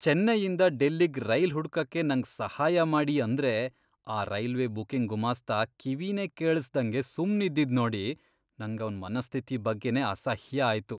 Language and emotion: Kannada, disgusted